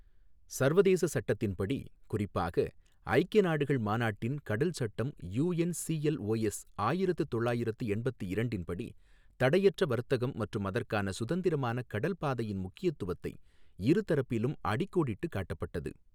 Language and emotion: Tamil, neutral